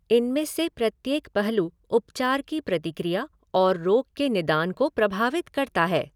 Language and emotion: Hindi, neutral